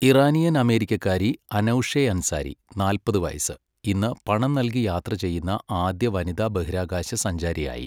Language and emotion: Malayalam, neutral